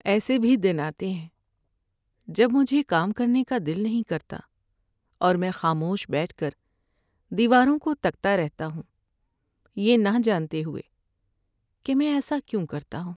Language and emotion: Urdu, sad